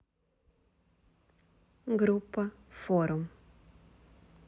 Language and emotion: Russian, neutral